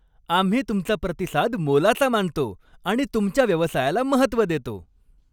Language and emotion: Marathi, happy